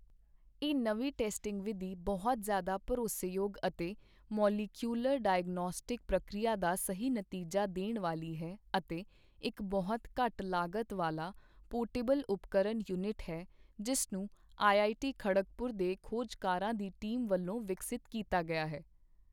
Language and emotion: Punjabi, neutral